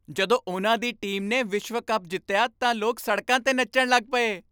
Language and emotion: Punjabi, happy